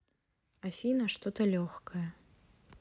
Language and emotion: Russian, neutral